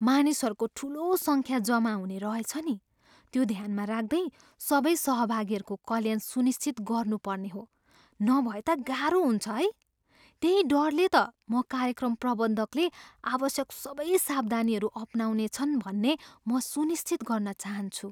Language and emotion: Nepali, fearful